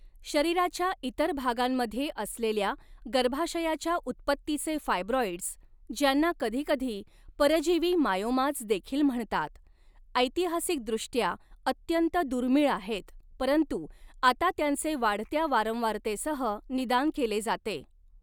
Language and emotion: Marathi, neutral